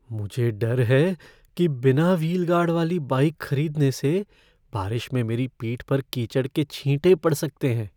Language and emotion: Hindi, fearful